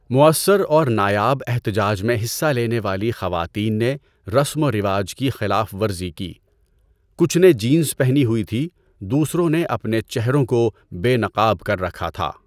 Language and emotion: Urdu, neutral